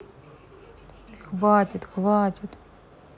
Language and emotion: Russian, sad